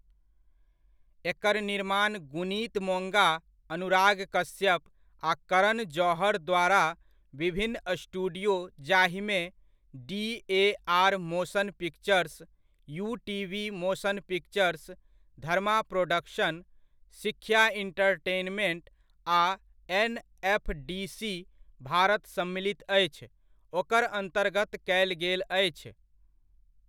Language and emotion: Maithili, neutral